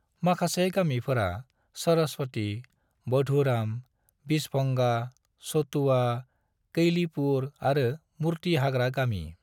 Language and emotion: Bodo, neutral